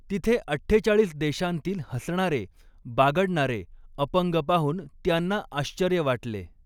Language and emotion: Marathi, neutral